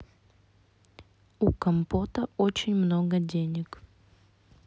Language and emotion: Russian, neutral